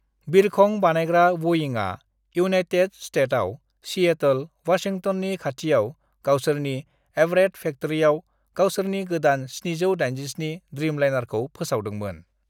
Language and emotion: Bodo, neutral